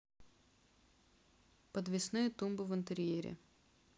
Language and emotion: Russian, neutral